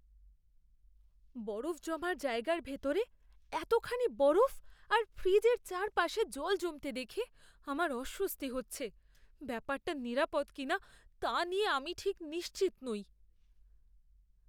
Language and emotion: Bengali, fearful